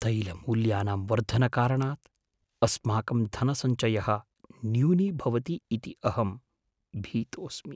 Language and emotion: Sanskrit, fearful